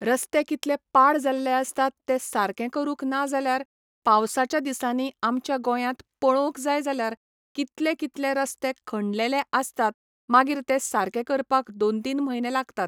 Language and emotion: Goan Konkani, neutral